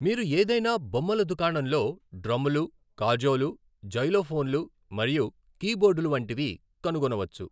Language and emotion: Telugu, neutral